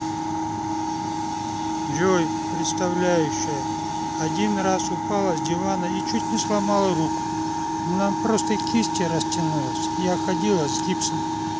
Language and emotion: Russian, sad